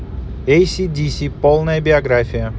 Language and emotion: Russian, positive